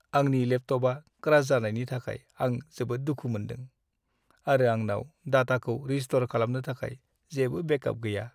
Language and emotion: Bodo, sad